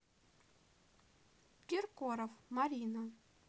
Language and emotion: Russian, neutral